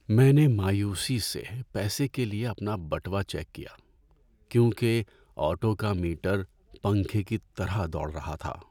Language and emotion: Urdu, sad